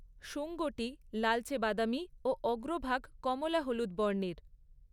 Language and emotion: Bengali, neutral